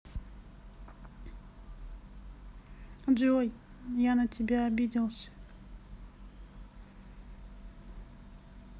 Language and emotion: Russian, sad